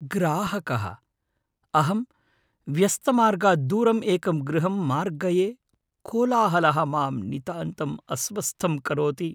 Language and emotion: Sanskrit, fearful